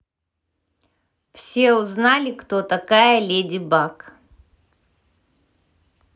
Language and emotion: Russian, neutral